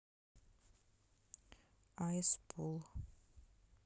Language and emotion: Russian, neutral